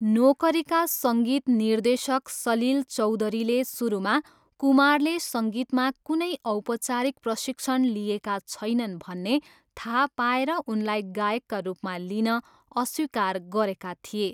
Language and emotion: Nepali, neutral